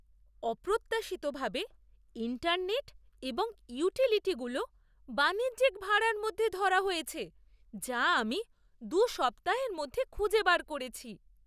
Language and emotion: Bengali, surprised